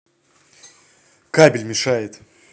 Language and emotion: Russian, angry